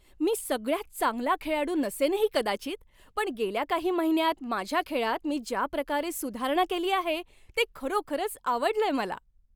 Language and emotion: Marathi, happy